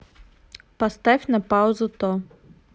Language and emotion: Russian, neutral